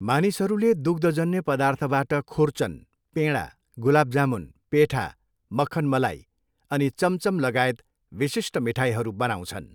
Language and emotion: Nepali, neutral